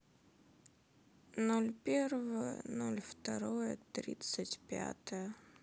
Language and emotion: Russian, sad